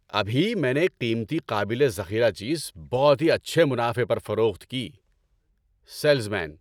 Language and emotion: Urdu, happy